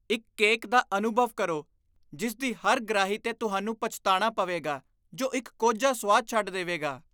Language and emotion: Punjabi, disgusted